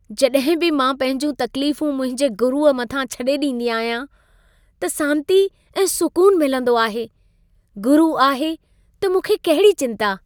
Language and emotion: Sindhi, happy